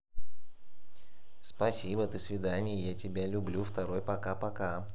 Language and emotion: Russian, positive